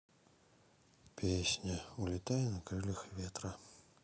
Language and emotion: Russian, sad